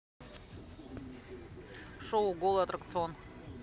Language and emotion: Russian, neutral